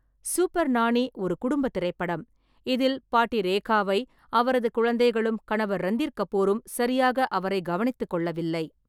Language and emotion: Tamil, neutral